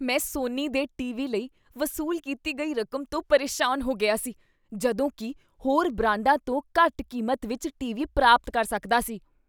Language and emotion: Punjabi, disgusted